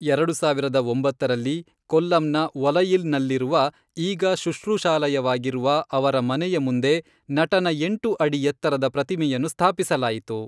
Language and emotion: Kannada, neutral